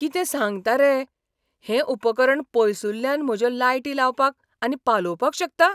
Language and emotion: Goan Konkani, surprised